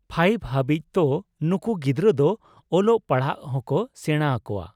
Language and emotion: Santali, neutral